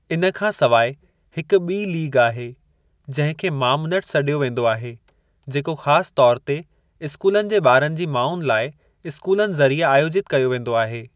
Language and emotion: Sindhi, neutral